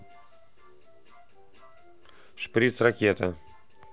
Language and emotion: Russian, neutral